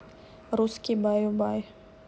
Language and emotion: Russian, neutral